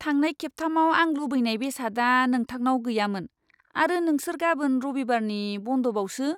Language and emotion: Bodo, disgusted